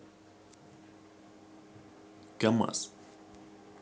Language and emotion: Russian, neutral